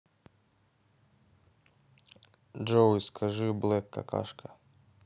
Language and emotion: Russian, neutral